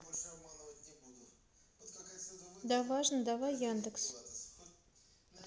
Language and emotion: Russian, neutral